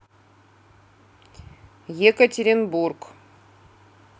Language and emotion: Russian, neutral